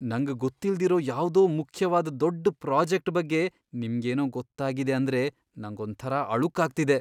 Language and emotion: Kannada, fearful